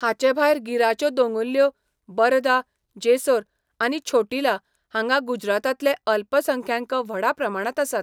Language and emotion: Goan Konkani, neutral